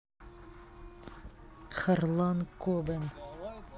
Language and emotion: Russian, neutral